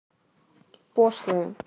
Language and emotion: Russian, neutral